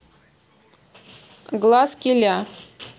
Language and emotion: Russian, neutral